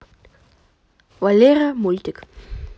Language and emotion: Russian, neutral